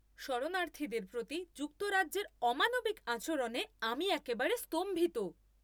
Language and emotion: Bengali, angry